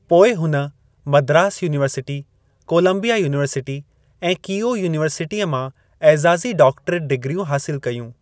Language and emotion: Sindhi, neutral